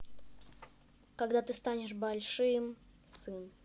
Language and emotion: Russian, neutral